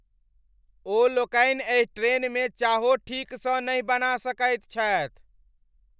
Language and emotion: Maithili, angry